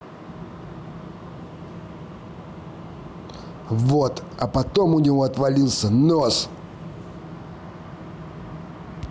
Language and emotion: Russian, angry